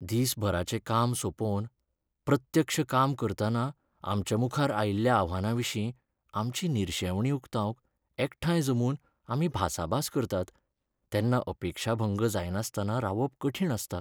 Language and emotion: Goan Konkani, sad